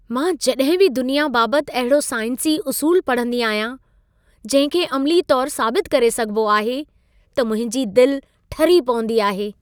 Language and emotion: Sindhi, happy